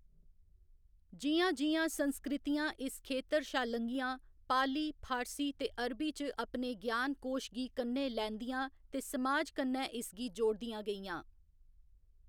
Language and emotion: Dogri, neutral